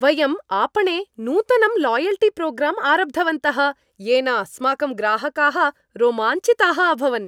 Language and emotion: Sanskrit, happy